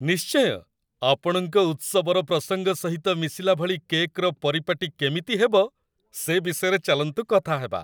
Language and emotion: Odia, happy